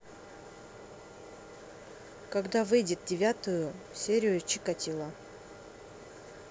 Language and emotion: Russian, neutral